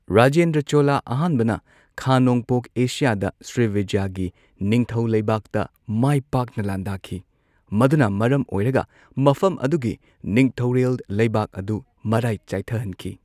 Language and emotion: Manipuri, neutral